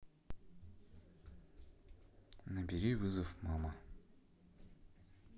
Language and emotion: Russian, neutral